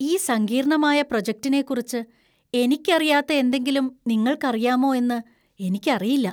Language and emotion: Malayalam, fearful